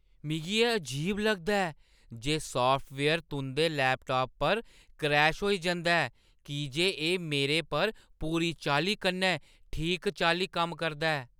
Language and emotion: Dogri, surprised